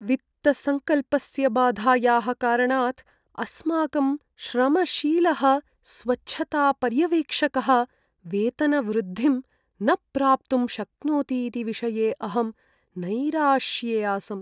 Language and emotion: Sanskrit, sad